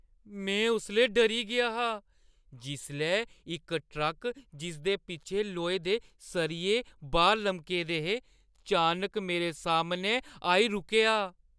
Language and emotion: Dogri, fearful